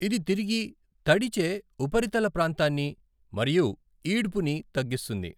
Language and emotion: Telugu, neutral